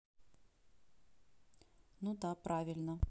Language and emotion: Russian, neutral